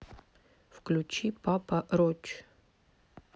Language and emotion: Russian, neutral